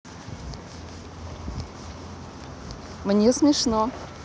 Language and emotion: Russian, positive